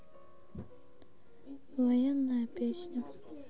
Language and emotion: Russian, sad